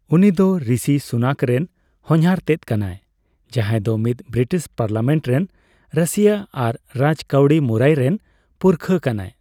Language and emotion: Santali, neutral